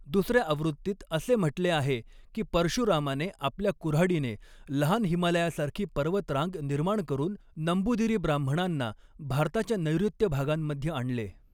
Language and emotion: Marathi, neutral